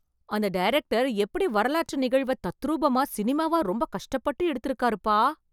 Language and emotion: Tamil, surprised